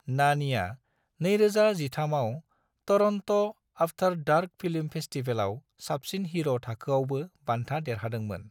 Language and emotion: Bodo, neutral